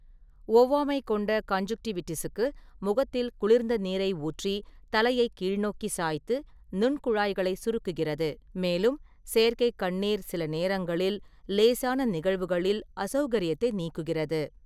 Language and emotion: Tamil, neutral